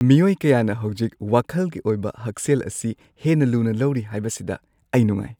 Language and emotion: Manipuri, happy